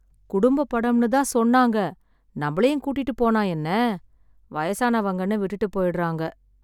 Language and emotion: Tamil, sad